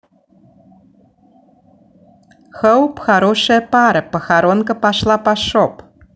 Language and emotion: Russian, neutral